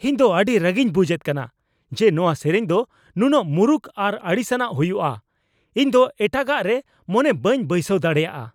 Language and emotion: Santali, angry